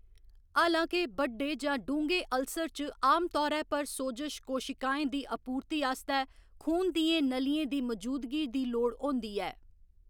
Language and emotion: Dogri, neutral